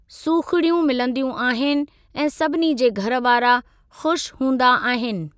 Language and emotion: Sindhi, neutral